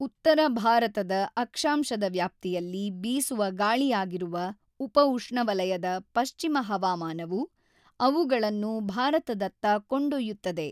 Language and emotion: Kannada, neutral